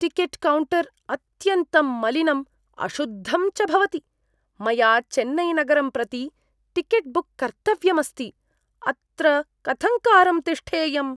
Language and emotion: Sanskrit, disgusted